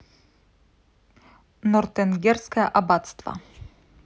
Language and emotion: Russian, neutral